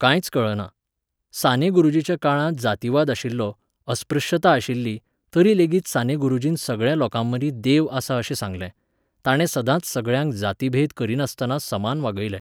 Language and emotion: Goan Konkani, neutral